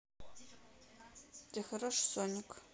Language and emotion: Russian, neutral